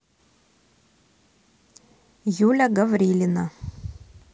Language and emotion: Russian, neutral